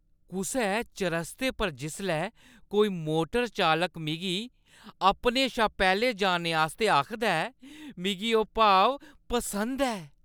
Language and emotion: Dogri, happy